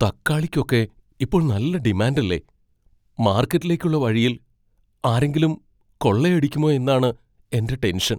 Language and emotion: Malayalam, fearful